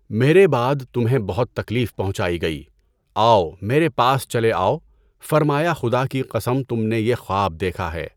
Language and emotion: Urdu, neutral